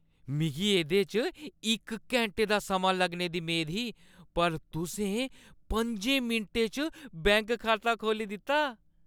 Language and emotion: Dogri, happy